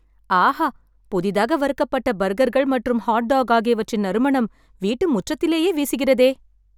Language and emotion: Tamil, happy